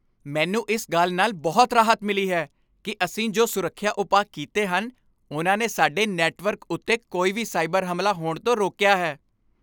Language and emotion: Punjabi, happy